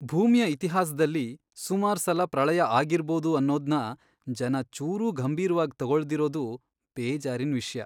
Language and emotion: Kannada, sad